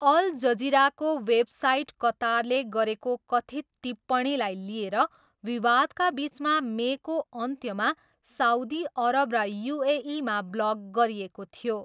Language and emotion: Nepali, neutral